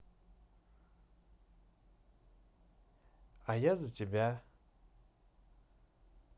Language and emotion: Russian, positive